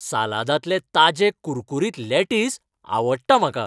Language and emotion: Goan Konkani, happy